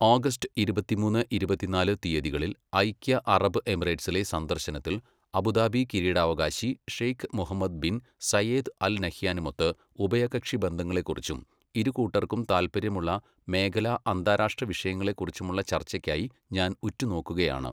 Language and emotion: Malayalam, neutral